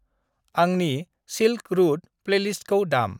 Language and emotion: Bodo, neutral